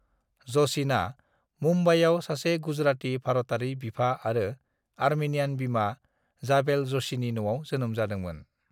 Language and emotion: Bodo, neutral